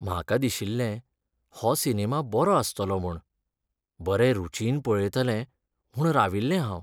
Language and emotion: Goan Konkani, sad